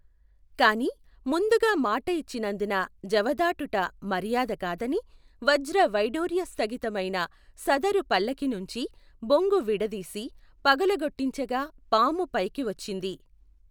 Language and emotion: Telugu, neutral